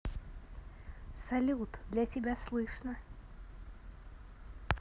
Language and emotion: Russian, positive